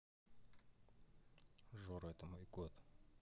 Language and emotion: Russian, neutral